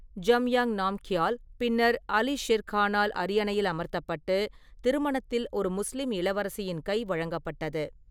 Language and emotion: Tamil, neutral